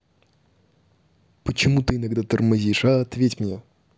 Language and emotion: Russian, angry